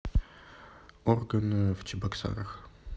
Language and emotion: Russian, neutral